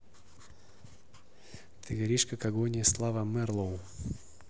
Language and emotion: Russian, neutral